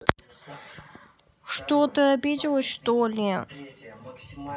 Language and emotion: Russian, sad